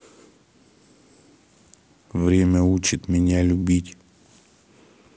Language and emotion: Russian, neutral